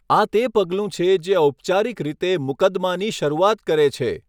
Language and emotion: Gujarati, neutral